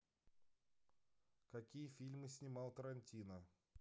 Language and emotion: Russian, neutral